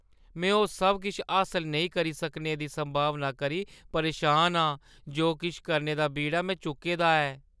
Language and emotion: Dogri, fearful